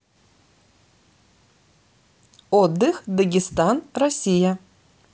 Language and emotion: Russian, neutral